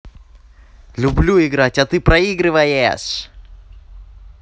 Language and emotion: Russian, positive